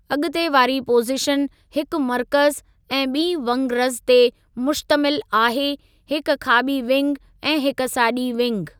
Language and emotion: Sindhi, neutral